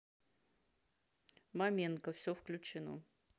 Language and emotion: Russian, neutral